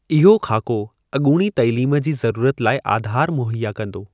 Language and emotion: Sindhi, neutral